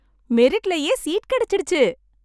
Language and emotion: Tamil, happy